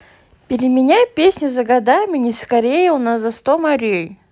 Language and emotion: Russian, positive